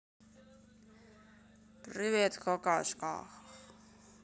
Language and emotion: Russian, neutral